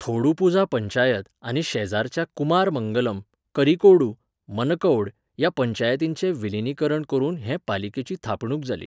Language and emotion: Goan Konkani, neutral